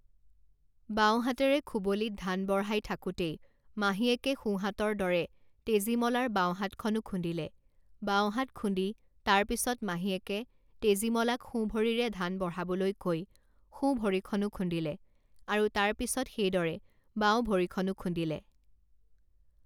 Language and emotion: Assamese, neutral